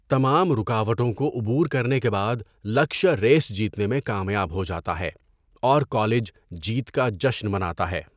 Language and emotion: Urdu, neutral